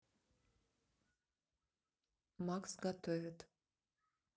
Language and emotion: Russian, neutral